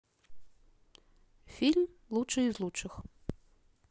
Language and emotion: Russian, neutral